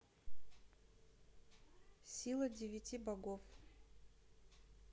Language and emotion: Russian, neutral